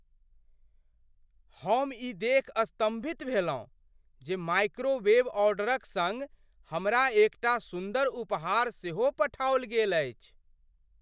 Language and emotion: Maithili, surprised